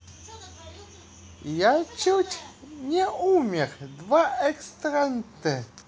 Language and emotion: Russian, positive